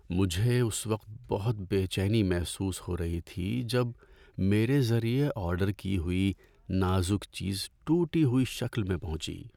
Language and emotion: Urdu, sad